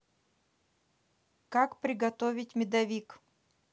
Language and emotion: Russian, neutral